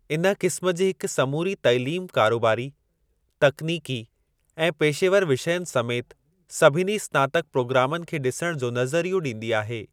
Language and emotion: Sindhi, neutral